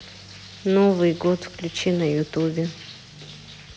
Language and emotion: Russian, neutral